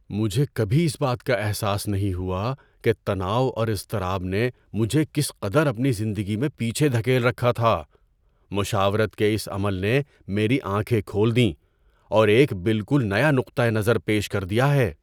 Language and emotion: Urdu, surprised